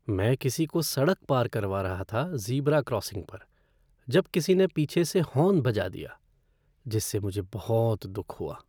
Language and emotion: Hindi, sad